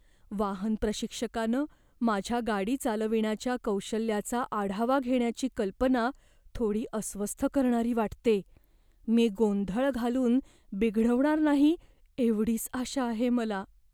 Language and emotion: Marathi, fearful